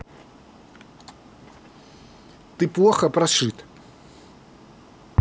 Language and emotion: Russian, angry